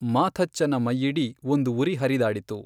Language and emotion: Kannada, neutral